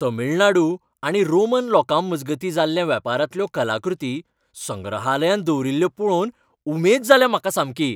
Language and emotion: Goan Konkani, happy